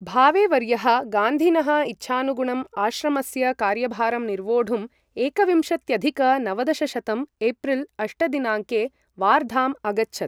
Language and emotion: Sanskrit, neutral